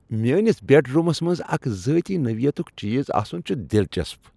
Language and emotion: Kashmiri, happy